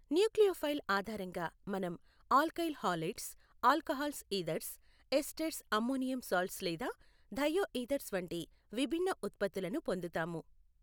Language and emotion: Telugu, neutral